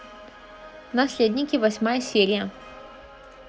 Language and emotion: Russian, positive